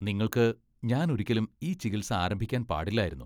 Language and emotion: Malayalam, disgusted